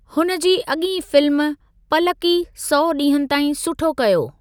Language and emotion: Sindhi, neutral